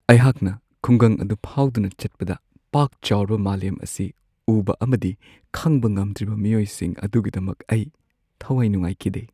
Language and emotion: Manipuri, sad